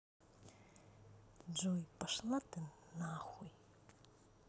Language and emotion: Russian, neutral